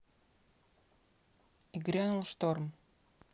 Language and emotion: Russian, neutral